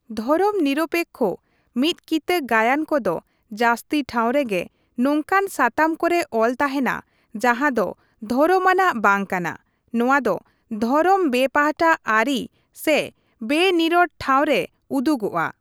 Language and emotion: Santali, neutral